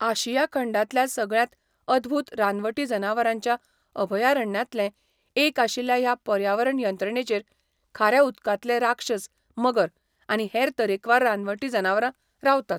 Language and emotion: Goan Konkani, neutral